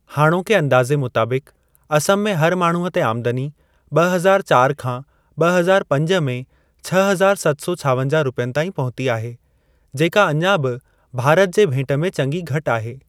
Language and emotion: Sindhi, neutral